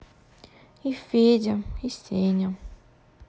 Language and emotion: Russian, sad